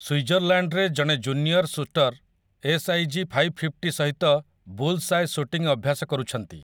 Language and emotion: Odia, neutral